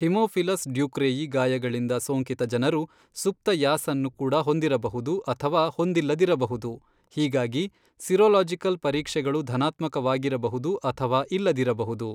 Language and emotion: Kannada, neutral